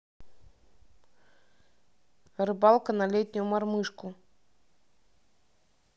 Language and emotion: Russian, neutral